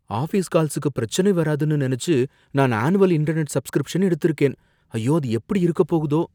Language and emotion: Tamil, fearful